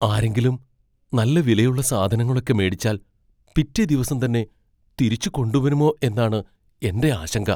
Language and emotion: Malayalam, fearful